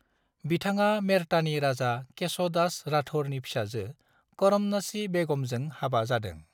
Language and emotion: Bodo, neutral